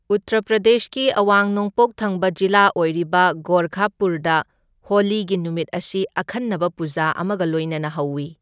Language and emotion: Manipuri, neutral